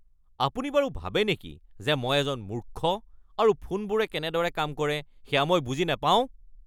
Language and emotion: Assamese, angry